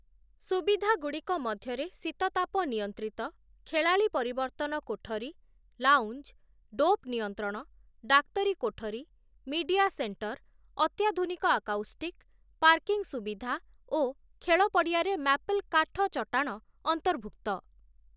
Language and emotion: Odia, neutral